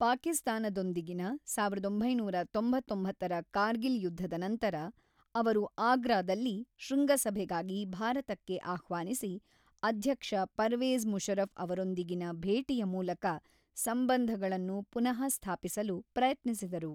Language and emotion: Kannada, neutral